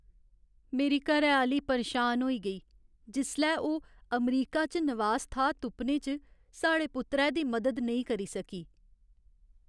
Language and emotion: Dogri, sad